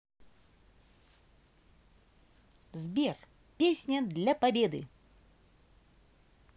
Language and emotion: Russian, positive